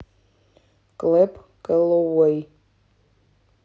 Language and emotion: Russian, neutral